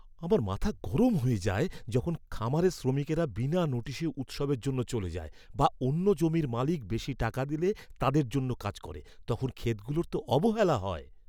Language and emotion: Bengali, angry